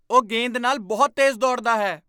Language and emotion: Punjabi, surprised